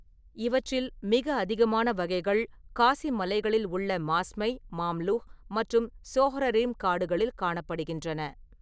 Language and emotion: Tamil, neutral